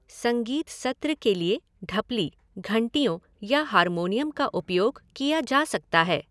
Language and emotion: Hindi, neutral